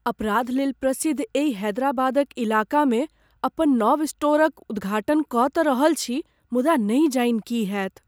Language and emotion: Maithili, fearful